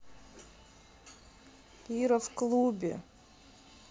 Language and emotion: Russian, sad